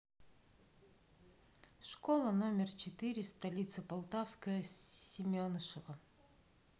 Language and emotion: Russian, neutral